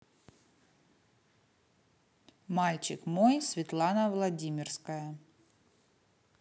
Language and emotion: Russian, neutral